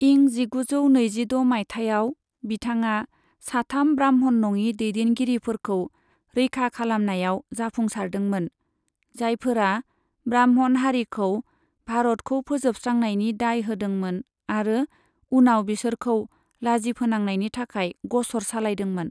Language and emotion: Bodo, neutral